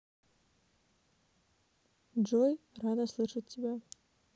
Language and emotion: Russian, neutral